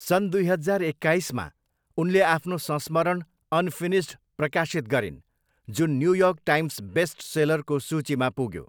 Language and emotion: Nepali, neutral